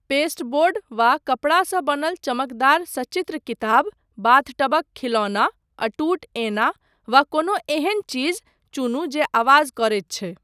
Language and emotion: Maithili, neutral